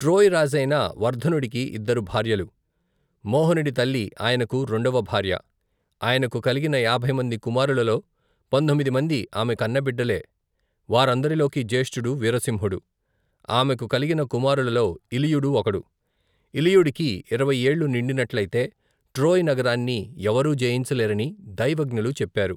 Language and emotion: Telugu, neutral